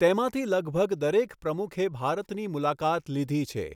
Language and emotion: Gujarati, neutral